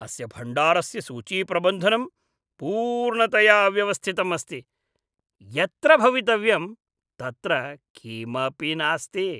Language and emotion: Sanskrit, disgusted